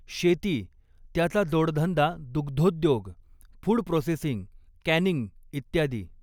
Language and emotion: Marathi, neutral